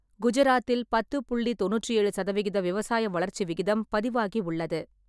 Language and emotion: Tamil, neutral